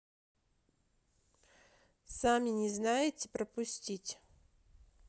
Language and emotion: Russian, neutral